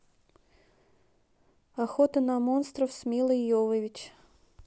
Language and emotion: Russian, neutral